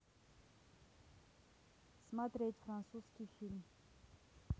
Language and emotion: Russian, neutral